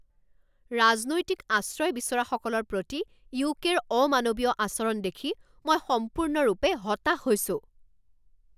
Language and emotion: Assamese, angry